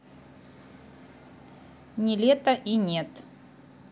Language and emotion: Russian, neutral